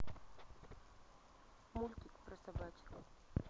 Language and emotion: Russian, neutral